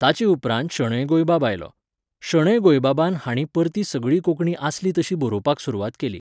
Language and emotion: Goan Konkani, neutral